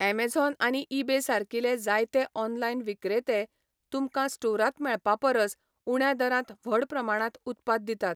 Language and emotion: Goan Konkani, neutral